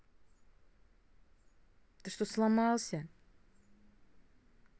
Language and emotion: Russian, angry